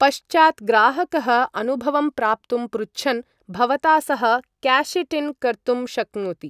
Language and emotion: Sanskrit, neutral